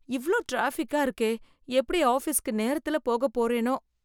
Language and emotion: Tamil, fearful